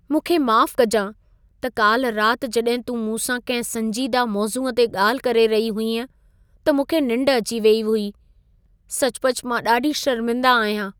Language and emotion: Sindhi, sad